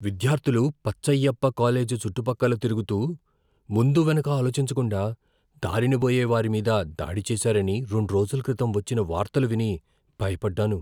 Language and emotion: Telugu, fearful